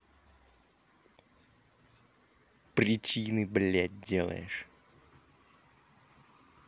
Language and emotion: Russian, angry